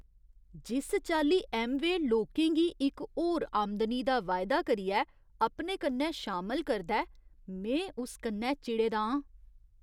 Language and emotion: Dogri, disgusted